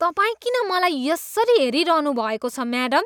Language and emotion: Nepali, disgusted